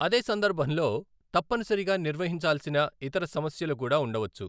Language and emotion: Telugu, neutral